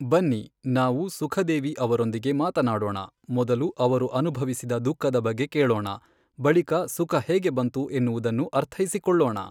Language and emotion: Kannada, neutral